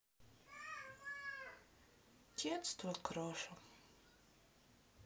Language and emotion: Russian, sad